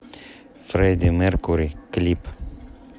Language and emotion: Russian, neutral